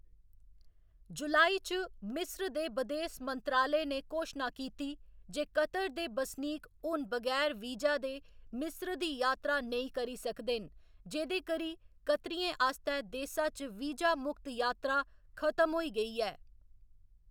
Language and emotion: Dogri, neutral